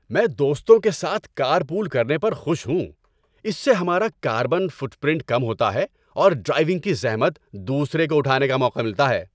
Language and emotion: Urdu, happy